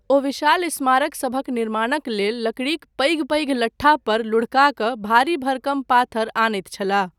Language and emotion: Maithili, neutral